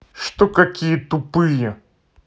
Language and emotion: Russian, angry